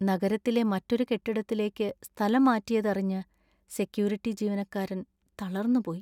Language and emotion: Malayalam, sad